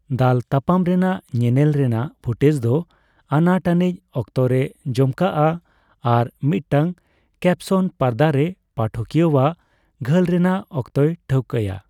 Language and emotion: Santali, neutral